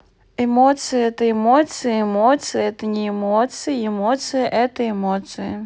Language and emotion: Russian, neutral